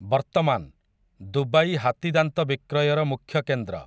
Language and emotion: Odia, neutral